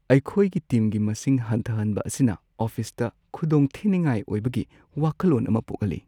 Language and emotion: Manipuri, sad